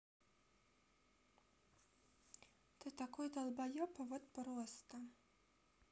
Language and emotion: Russian, neutral